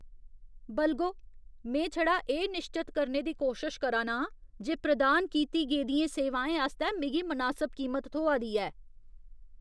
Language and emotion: Dogri, disgusted